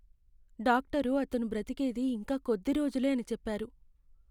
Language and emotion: Telugu, sad